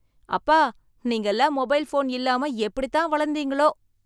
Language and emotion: Tamil, surprised